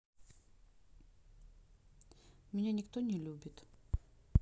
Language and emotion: Russian, sad